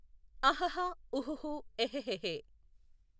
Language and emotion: Telugu, neutral